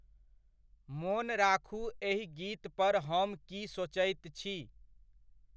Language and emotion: Maithili, neutral